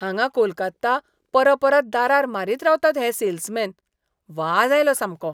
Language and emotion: Goan Konkani, disgusted